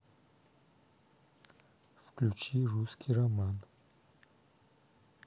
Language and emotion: Russian, neutral